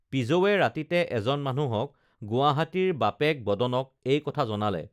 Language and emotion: Assamese, neutral